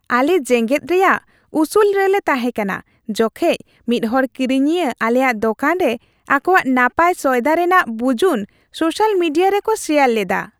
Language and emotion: Santali, happy